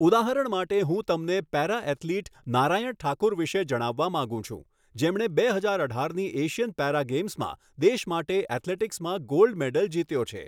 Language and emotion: Gujarati, neutral